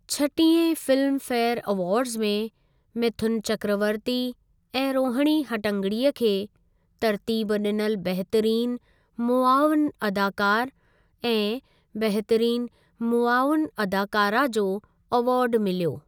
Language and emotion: Sindhi, neutral